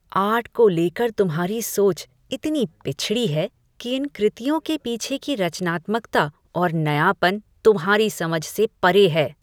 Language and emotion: Hindi, disgusted